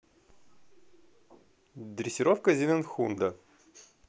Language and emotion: Russian, positive